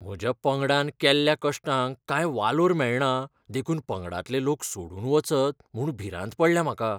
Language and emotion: Goan Konkani, fearful